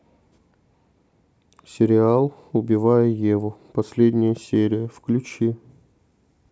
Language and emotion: Russian, neutral